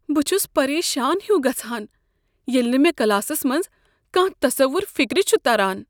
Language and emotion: Kashmiri, fearful